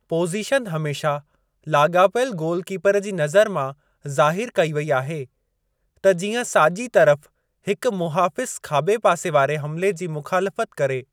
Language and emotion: Sindhi, neutral